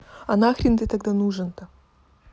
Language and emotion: Russian, neutral